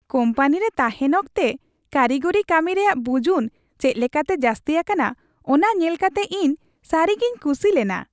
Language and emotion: Santali, happy